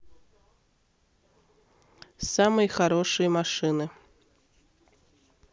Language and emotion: Russian, neutral